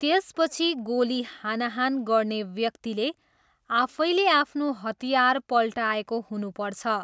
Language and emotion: Nepali, neutral